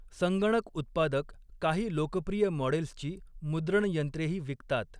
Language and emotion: Marathi, neutral